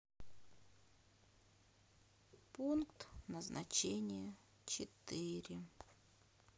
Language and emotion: Russian, sad